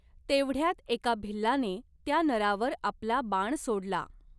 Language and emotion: Marathi, neutral